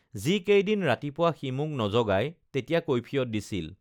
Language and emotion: Assamese, neutral